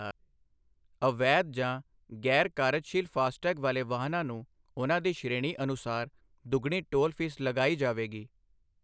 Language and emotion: Punjabi, neutral